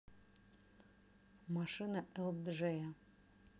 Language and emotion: Russian, neutral